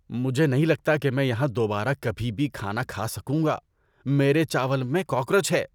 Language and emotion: Urdu, disgusted